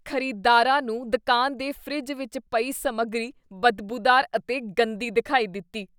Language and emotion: Punjabi, disgusted